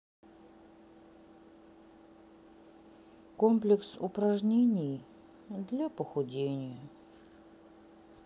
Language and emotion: Russian, sad